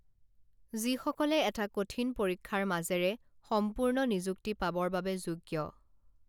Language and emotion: Assamese, neutral